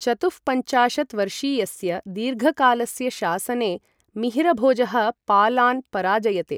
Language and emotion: Sanskrit, neutral